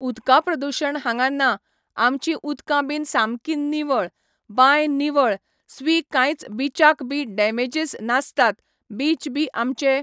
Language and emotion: Goan Konkani, neutral